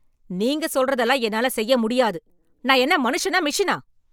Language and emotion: Tamil, angry